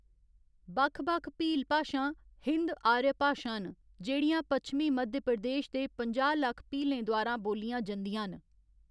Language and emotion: Dogri, neutral